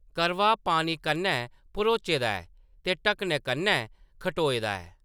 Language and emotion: Dogri, neutral